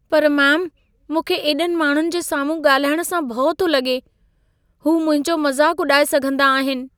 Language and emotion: Sindhi, fearful